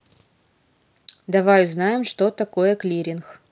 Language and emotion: Russian, neutral